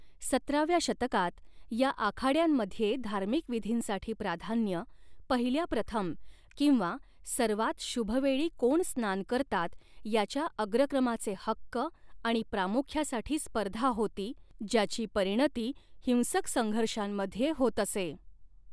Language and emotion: Marathi, neutral